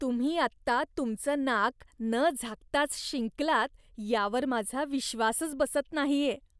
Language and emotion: Marathi, disgusted